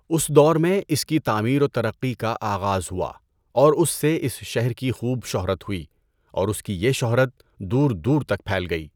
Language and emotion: Urdu, neutral